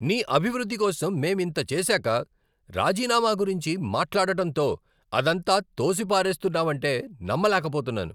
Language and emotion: Telugu, angry